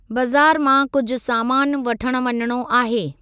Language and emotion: Sindhi, neutral